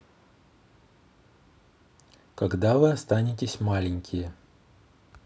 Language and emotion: Russian, neutral